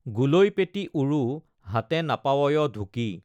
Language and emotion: Assamese, neutral